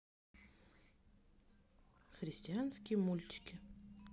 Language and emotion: Russian, neutral